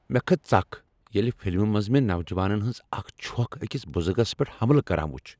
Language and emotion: Kashmiri, angry